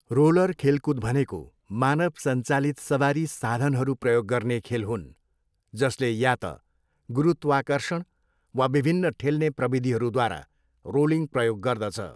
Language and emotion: Nepali, neutral